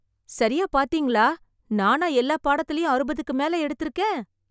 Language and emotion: Tamil, surprised